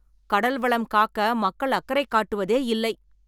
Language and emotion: Tamil, angry